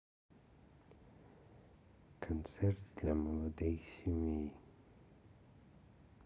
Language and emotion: Russian, sad